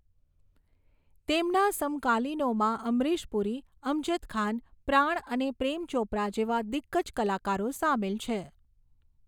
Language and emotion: Gujarati, neutral